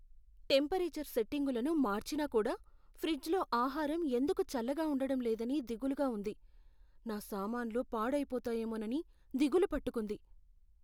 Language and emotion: Telugu, fearful